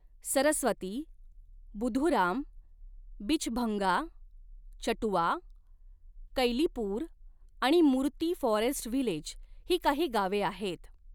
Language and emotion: Marathi, neutral